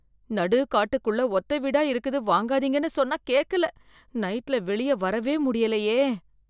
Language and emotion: Tamil, fearful